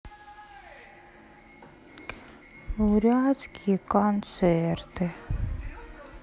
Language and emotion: Russian, sad